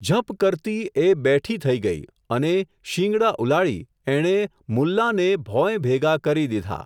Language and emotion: Gujarati, neutral